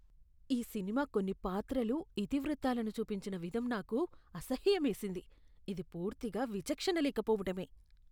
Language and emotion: Telugu, disgusted